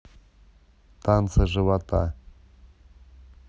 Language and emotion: Russian, neutral